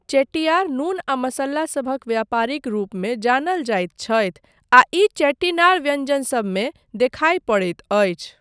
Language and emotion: Maithili, neutral